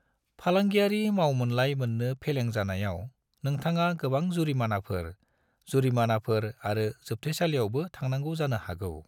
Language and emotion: Bodo, neutral